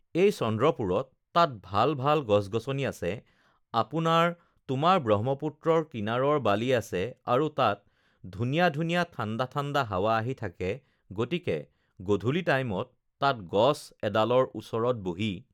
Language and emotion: Assamese, neutral